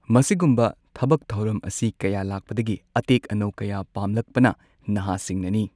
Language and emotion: Manipuri, neutral